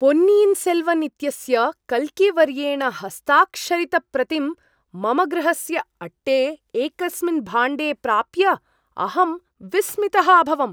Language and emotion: Sanskrit, surprised